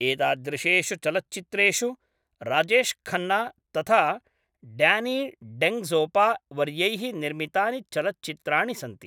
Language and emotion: Sanskrit, neutral